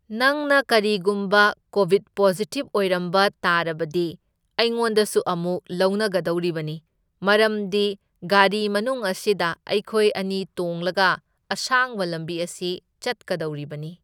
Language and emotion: Manipuri, neutral